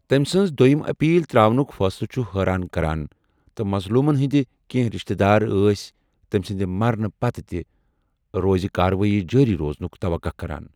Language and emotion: Kashmiri, neutral